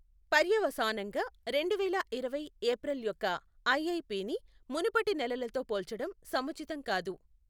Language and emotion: Telugu, neutral